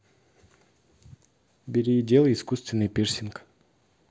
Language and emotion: Russian, neutral